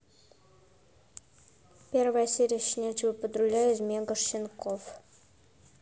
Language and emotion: Russian, neutral